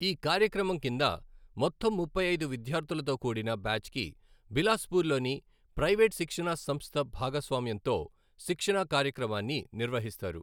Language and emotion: Telugu, neutral